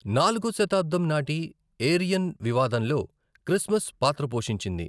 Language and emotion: Telugu, neutral